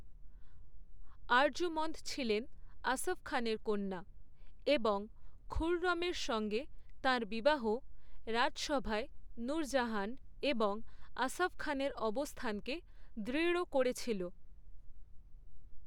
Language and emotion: Bengali, neutral